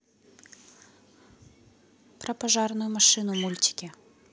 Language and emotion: Russian, neutral